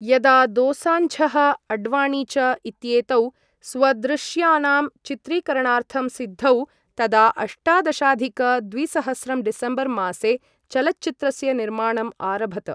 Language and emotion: Sanskrit, neutral